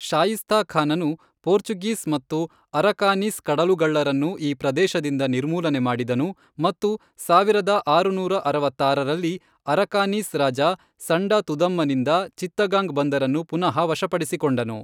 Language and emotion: Kannada, neutral